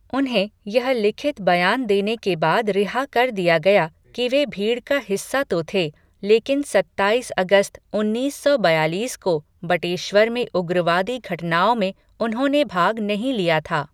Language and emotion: Hindi, neutral